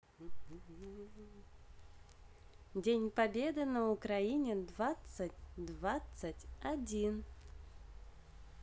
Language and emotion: Russian, positive